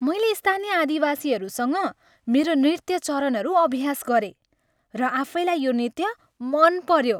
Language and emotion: Nepali, happy